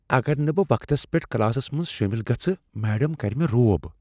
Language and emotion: Kashmiri, fearful